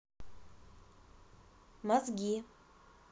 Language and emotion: Russian, neutral